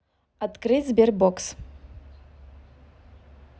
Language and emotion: Russian, neutral